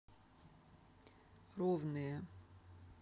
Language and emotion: Russian, neutral